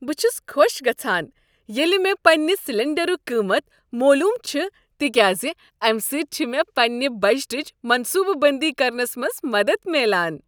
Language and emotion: Kashmiri, happy